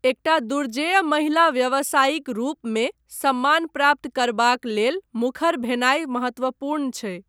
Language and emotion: Maithili, neutral